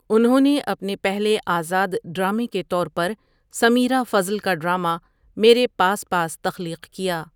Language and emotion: Urdu, neutral